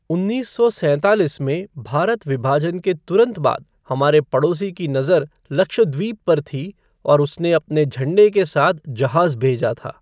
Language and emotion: Hindi, neutral